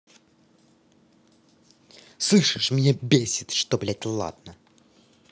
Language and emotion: Russian, angry